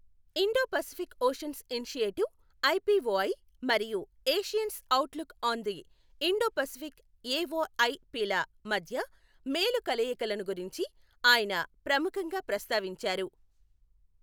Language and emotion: Telugu, neutral